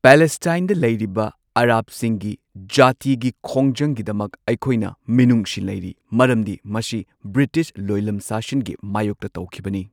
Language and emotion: Manipuri, neutral